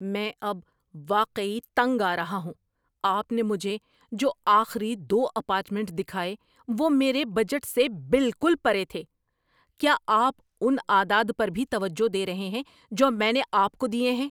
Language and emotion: Urdu, angry